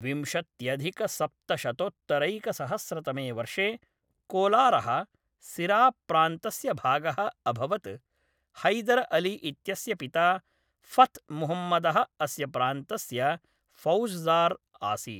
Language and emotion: Sanskrit, neutral